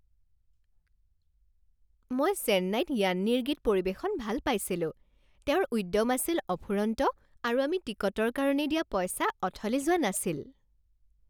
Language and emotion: Assamese, happy